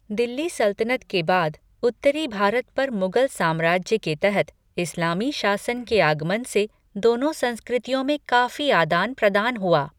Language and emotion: Hindi, neutral